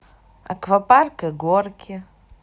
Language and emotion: Russian, positive